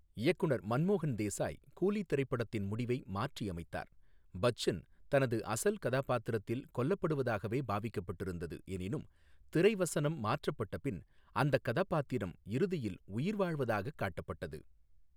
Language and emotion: Tamil, neutral